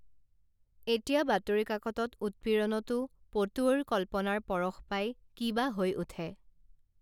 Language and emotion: Assamese, neutral